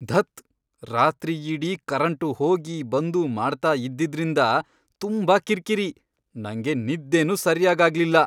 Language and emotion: Kannada, angry